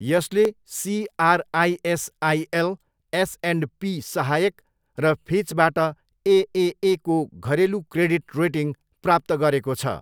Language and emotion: Nepali, neutral